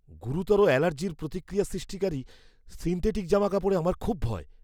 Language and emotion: Bengali, fearful